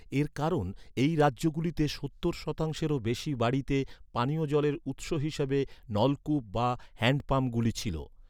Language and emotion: Bengali, neutral